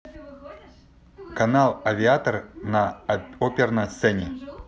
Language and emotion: Russian, neutral